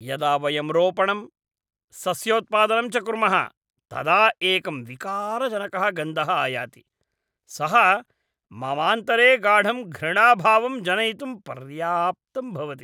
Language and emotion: Sanskrit, disgusted